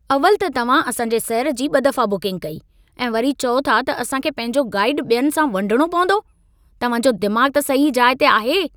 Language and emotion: Sindhi, angry